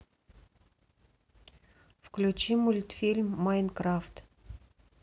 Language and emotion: Russian, neutral